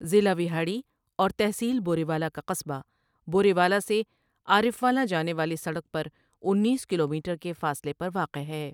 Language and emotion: Urdu, neutral